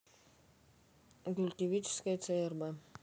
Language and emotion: Russian, neutral